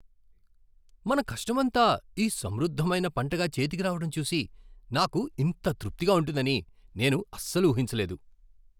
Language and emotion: Telugu, surprised